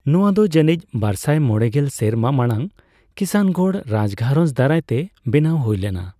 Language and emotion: Santali, neutral